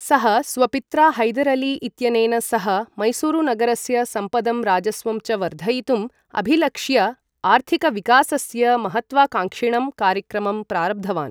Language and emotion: Sanskrit, neutral